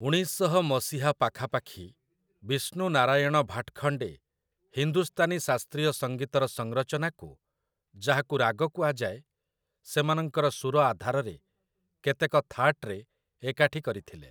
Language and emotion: Odia, neutral